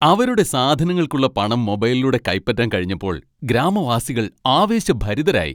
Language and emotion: Malayalam, happy